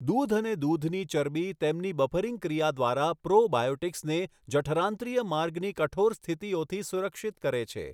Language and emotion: Gujarati, neutral